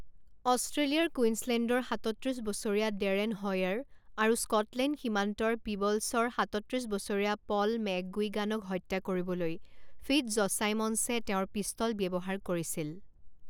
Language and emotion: Assamese, neutral